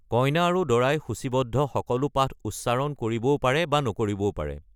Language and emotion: Assamese, neutral